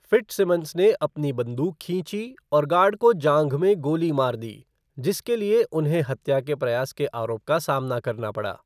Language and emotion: Hindi, neutral